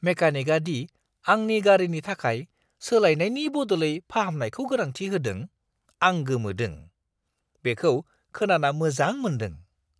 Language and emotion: Bodo, surprised